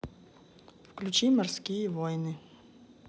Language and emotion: Russian, neutral